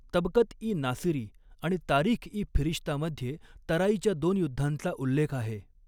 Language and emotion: Marathi, neutral